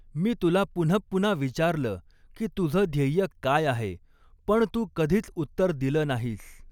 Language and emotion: Marathi, neutral